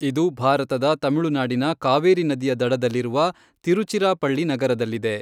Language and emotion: Kannada, neutral